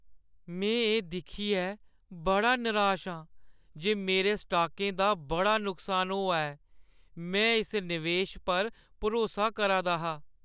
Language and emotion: Dogri, sad